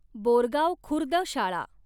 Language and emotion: Marathi, neutral